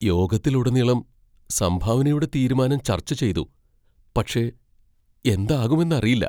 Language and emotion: Malayalam, fearful